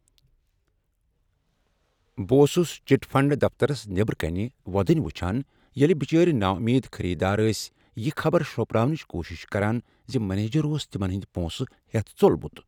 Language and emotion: Kashmiri, sad